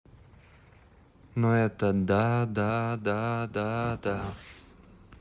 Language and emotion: Russian, neutral